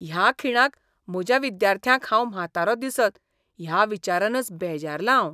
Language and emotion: Goan Konkani, disgusted